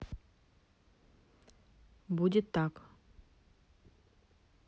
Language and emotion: Russian, neutral